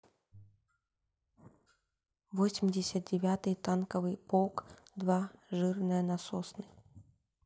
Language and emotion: Russian, neutral